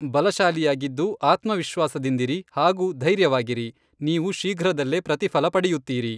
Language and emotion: Kannada, neutral